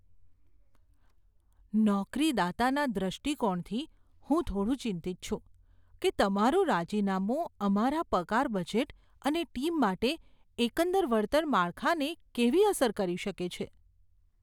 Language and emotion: Gujarati, fearful